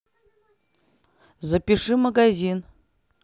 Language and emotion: Russian, neutral